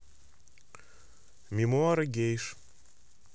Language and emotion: Russian, neutral